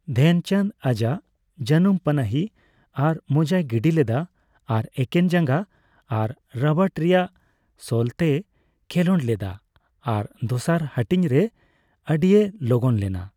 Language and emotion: Santali, neutral